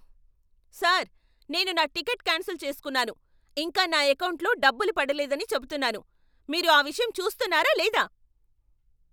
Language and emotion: Telugu, angry